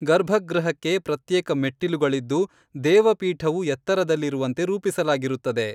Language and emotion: Kannada, neutral